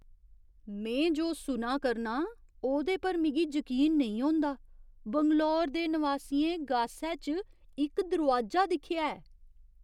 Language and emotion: Dogri, surprised